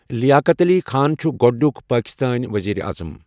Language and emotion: Kashmiri, neutral